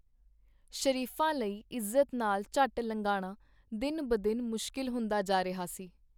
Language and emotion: Punjabi, neutral